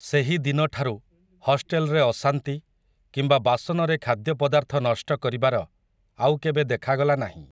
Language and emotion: Odia, neutral